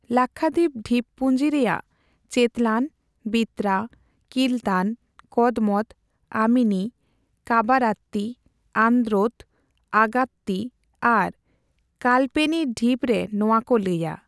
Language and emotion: Santali, neutral